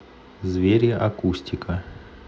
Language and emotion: Russian, neutral